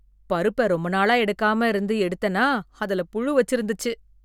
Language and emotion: Tamil, disgusted